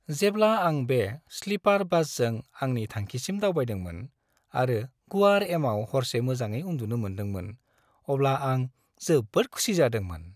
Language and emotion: Bodo, happy